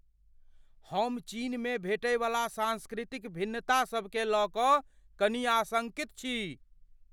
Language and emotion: Maithili, fearful